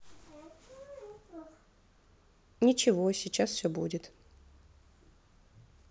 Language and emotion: Russian, neutral